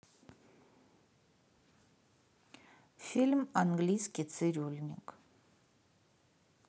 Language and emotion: Russian, neutral